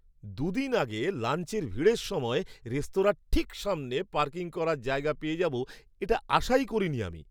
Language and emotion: Bengali, surprised